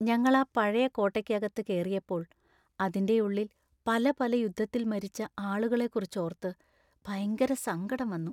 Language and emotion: Malayalam, sad